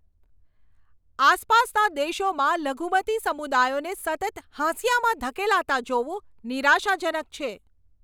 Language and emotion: Gujarati, angry